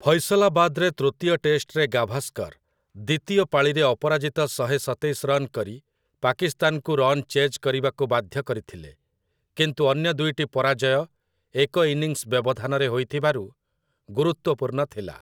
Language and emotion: Odia, neutral